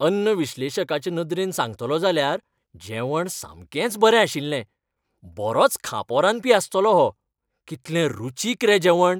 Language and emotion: Goan Konkani, happy